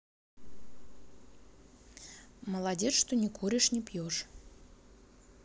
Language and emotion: Russian, neutral